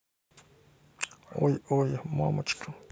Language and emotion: Russian, neutral